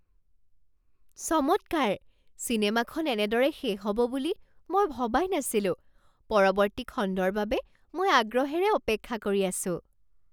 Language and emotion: Assamese, surprised